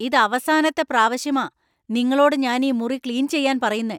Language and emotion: Malayalam, angry